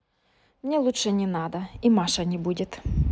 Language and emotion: Russian, neutral